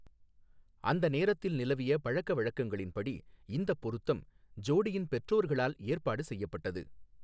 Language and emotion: Tamil, neutral